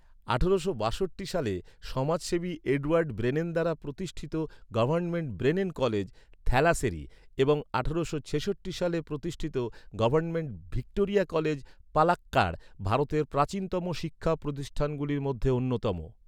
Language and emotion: Bengali, neutral